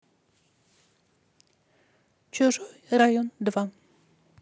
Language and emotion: Russian, neutral